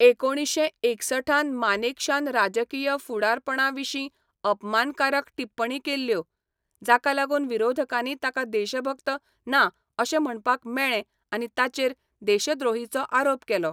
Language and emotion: Goan Konkani, neutral